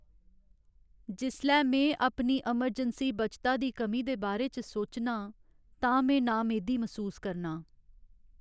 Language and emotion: Dogri, sad